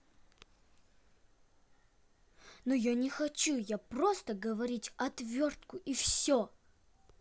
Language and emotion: Russian, angry